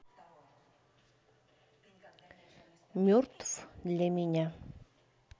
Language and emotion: Russian, neutral